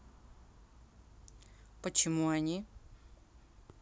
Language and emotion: Russian, neutral